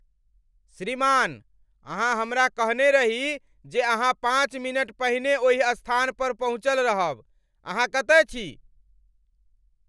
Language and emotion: Maithili, angry